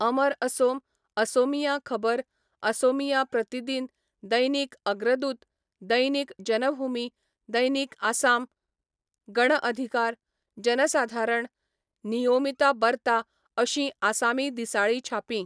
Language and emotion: Goan Konkani, neutral